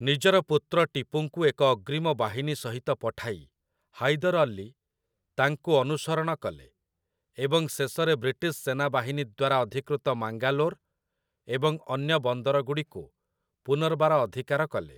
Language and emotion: Odia, neutral